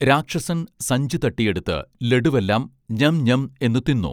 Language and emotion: Malayalam, neutral